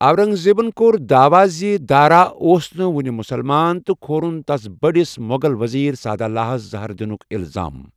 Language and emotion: Kashmiri, neutral